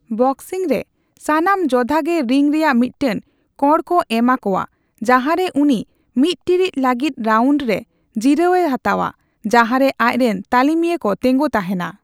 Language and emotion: Santali, neutral